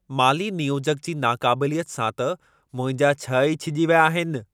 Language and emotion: Sindhi, angry